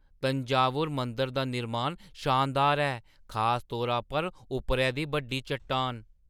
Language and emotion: Dogri, surprised